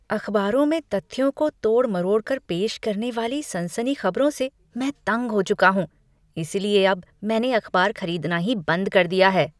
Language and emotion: Hindi, disgusted